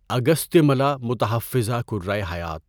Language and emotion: Urdu, neutral